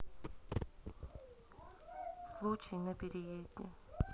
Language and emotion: Russian, neutral